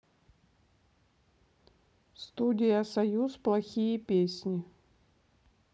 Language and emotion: Russian, neutral